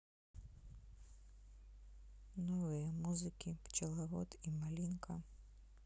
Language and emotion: Russian, sad